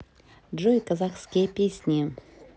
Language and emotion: Russian, neutral